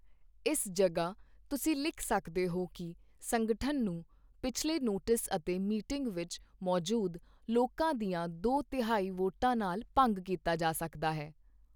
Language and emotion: Punjabi, neutral